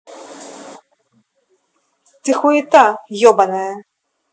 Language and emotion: Russian, angry